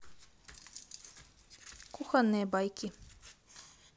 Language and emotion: Russian, neutral